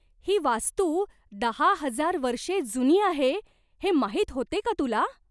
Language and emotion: Marathi, surprised